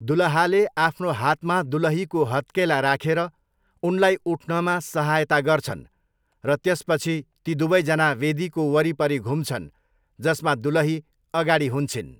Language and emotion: Nepali, neutral